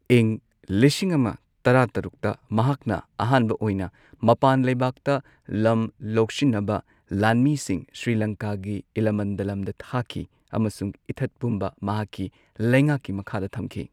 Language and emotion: Manipuri, neutral